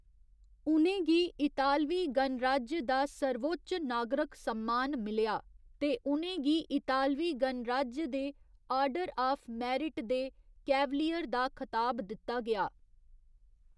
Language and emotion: Dogri, neutral